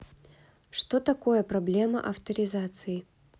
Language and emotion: Russian, neutral